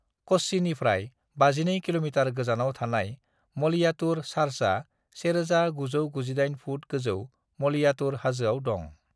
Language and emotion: Bodo, neutral